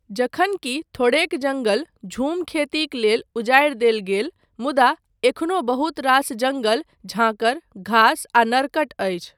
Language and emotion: Maithili, neutral